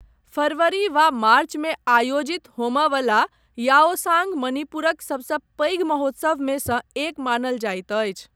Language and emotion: Maithili, neutral